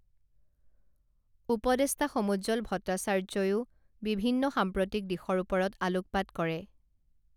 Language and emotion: Assamese, neutral